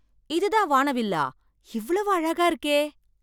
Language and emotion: Tamil, surprised